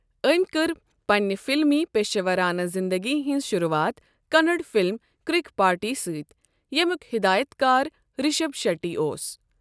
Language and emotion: Kashmiri, neutral